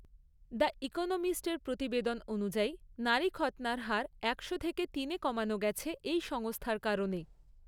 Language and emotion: Bengali, neutral